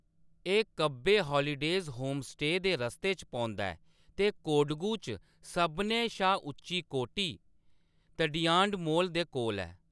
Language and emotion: Dogri, neutral